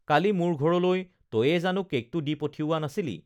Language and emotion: Assamese, neutral